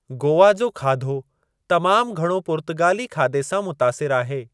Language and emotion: Sindhi, neutral